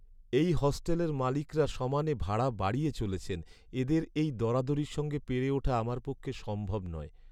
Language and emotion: Bengali, sad